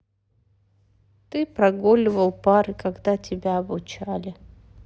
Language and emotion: Russian, sad